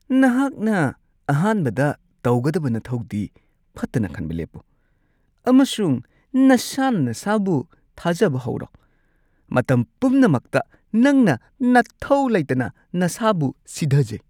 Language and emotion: Manipuri, disgusted